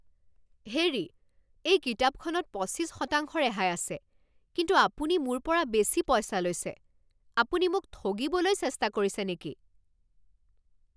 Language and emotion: Assamese, angry